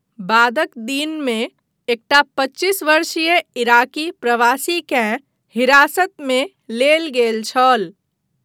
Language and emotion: Maithili, neutral